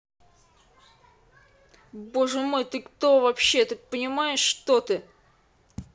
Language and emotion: Russian, angry